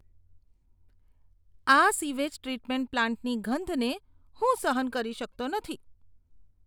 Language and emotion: Gujarati, disgusted